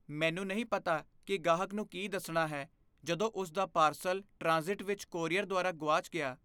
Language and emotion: Punjabi, fearful